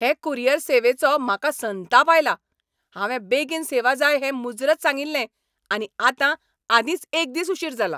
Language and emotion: Goan Konkani, angry